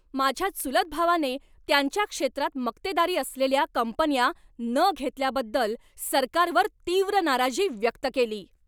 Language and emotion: Marathi, angry